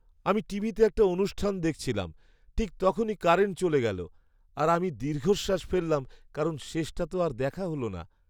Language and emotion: Bengali, sad